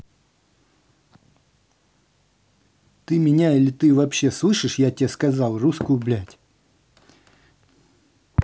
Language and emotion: Russian, angry